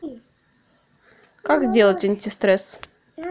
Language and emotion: Russian, neutral